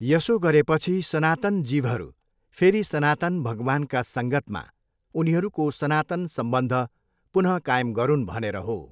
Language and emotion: Nepali, neutral